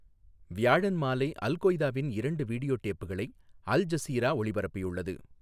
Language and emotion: Tamil, neutral